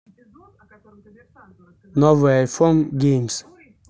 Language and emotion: Russian, neutral